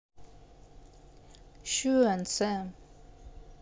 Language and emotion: Russian, neutral